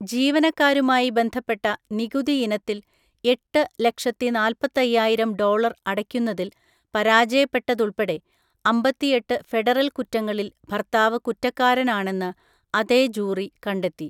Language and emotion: Malayalam, neutral